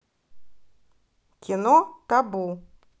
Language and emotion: Russian, neutral